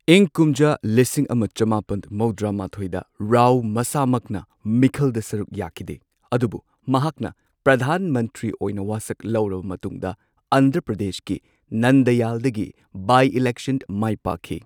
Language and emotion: Manipuri, neutral